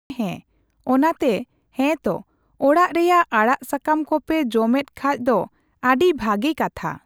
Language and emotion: Santali, neutral